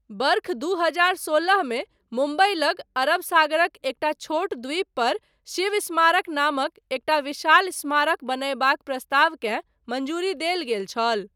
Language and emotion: Maithili, neutral